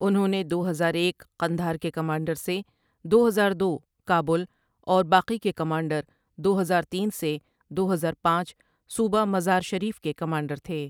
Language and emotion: Urdu, neutral